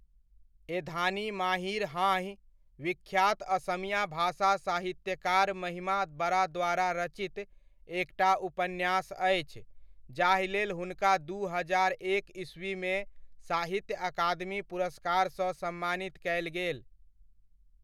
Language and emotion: Maithili, neutral